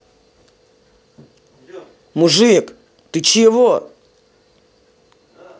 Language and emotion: Russian, angry